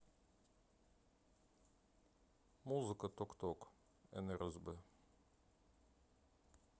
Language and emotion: Russian, neutral